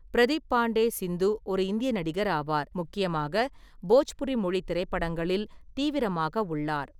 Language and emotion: Tamil, neutral